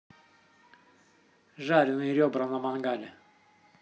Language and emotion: Russian, neutral